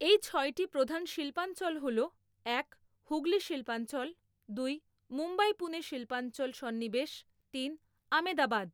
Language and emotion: Bengali, neutral